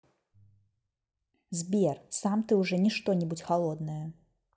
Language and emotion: Russian, neutral